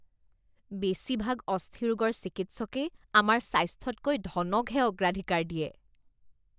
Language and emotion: Assamese, disgusted